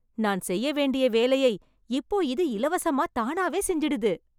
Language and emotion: Tamil, happy